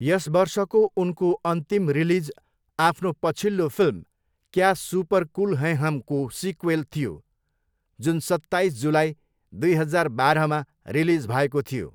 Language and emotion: Nepali, neutral